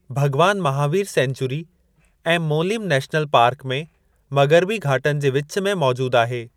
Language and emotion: Sindhi, neutral